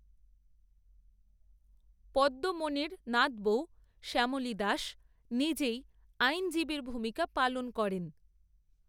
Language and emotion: Bengali, neutral